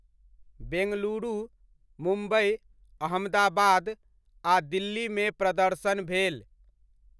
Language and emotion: Maithili, neutral